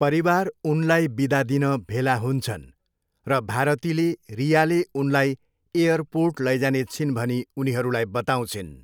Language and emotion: Nepali, neutral